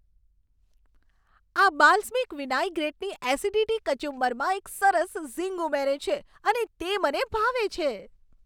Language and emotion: Gujarati, happy